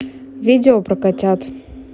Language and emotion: Russian, neutral